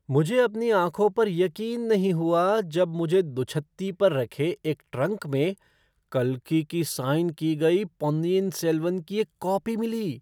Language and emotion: Hindi, surprised